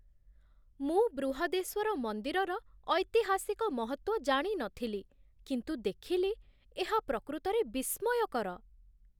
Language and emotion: Odia, surprised